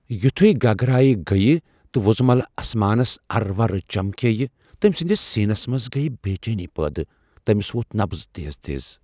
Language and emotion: Kashmiri, fearful